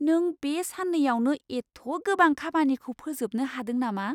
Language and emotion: Bodo, surprised